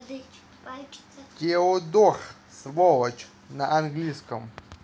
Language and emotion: Russian, neutral